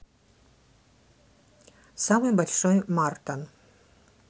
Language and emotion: Russian, neutral